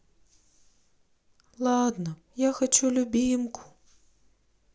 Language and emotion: Russian, sad